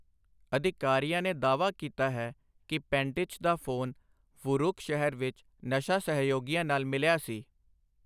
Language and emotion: Punjabi, neutral